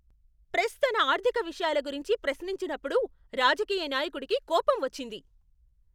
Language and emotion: Telugu, angry